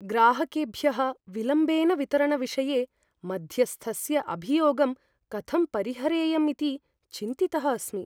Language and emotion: Sanskrit, fearful